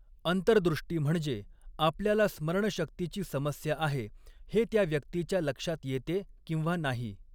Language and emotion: Marathi, neutral